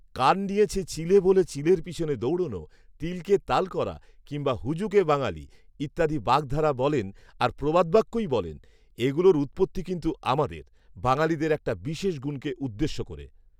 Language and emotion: Bengali, neutral